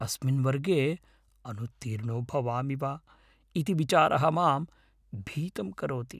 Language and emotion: Sanskrit, fearful